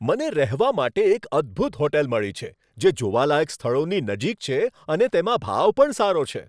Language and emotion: Gujarati, happy